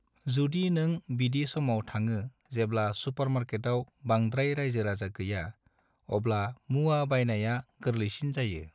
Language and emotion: Bodo, neutral